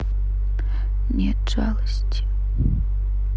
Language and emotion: Russian, sad